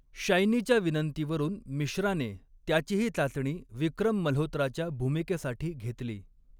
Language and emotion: Marathi, neutral